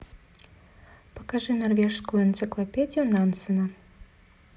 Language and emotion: Russian, neutral